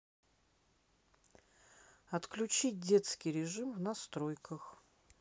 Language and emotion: Russian, neutral